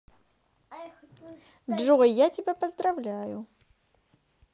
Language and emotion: Russian, positive